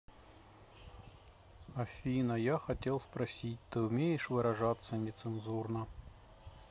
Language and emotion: Russian, neutral